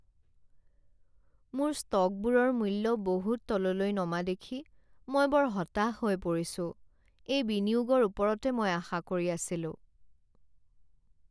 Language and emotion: Assamese, sad